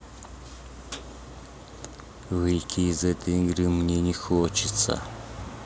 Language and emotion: Russian, neutral